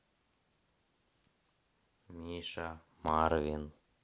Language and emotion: Russian, neutral